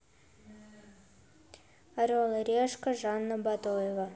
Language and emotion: Russian, neutral